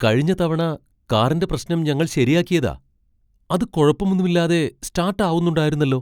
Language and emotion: Malayalam, surprised